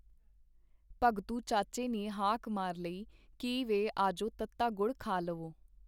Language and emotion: Punjabi, neutral